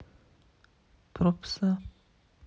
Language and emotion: Russian, sad